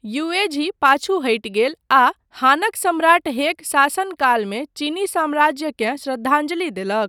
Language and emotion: Maithili, neutral